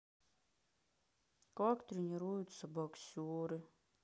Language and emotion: Russian, sad